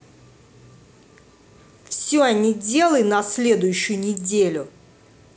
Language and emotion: Russian, angry